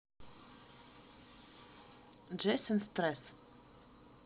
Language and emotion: Russian, neutral